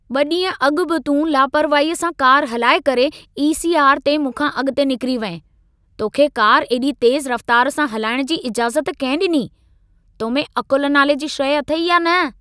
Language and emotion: Sindhi, angry